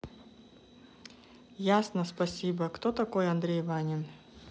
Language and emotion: Russian, neutral